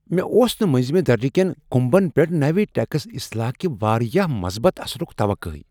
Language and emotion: Kashmiri, surprised